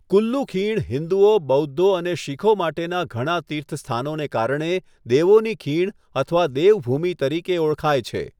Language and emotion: Gujarati, neutral